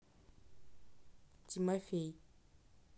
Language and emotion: Russian, angry